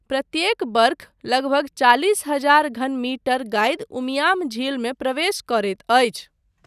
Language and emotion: Maithili, neutral